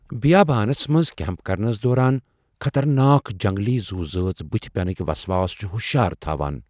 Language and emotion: Kashmiri, fearful